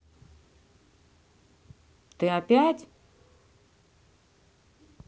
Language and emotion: Russian, angry